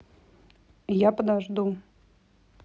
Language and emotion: Russian, neutral